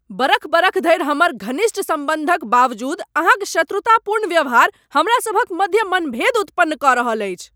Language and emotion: Maithili, angry